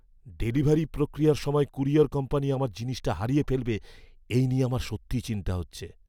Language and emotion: Bengali, fearful